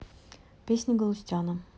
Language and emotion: Russian, neutral